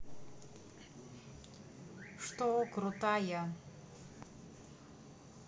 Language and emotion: Russian, neutral